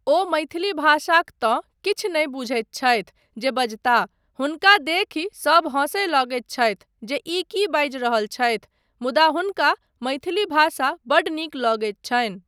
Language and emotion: Maithili, neutral